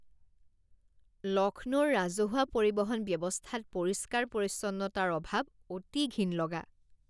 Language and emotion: Assamese, disgusted